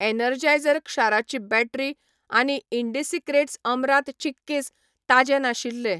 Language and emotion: Goan Konkani, neutral